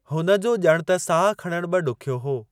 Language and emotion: Sindhi, neutral